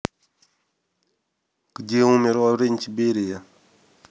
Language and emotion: Russian, neutral